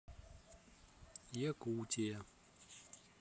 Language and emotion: Russian, neutral